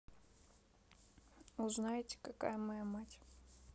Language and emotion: Russian, sad